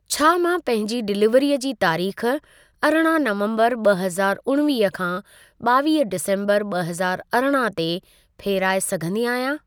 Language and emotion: Sindhi, neutral